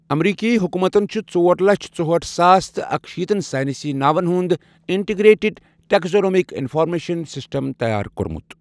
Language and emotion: Kashmiri, neutral